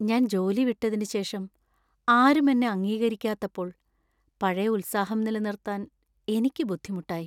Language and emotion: Malayalam, sad